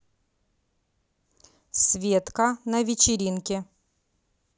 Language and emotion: Russian, neutral